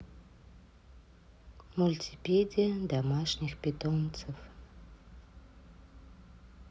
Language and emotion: Russian, sad